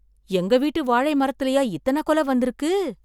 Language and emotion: Tamil, surprised